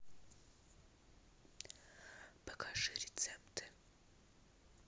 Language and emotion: Russian, neutral